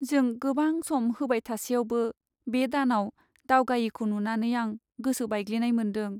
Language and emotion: Bodo, sad